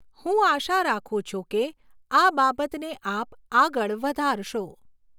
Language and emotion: Gujarati, neutral